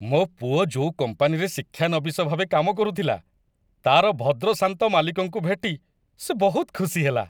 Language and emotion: Odia, happy